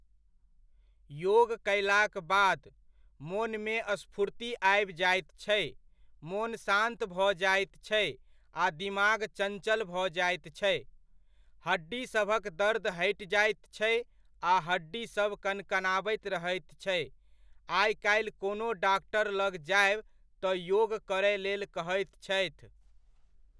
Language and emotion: Maithili, neutral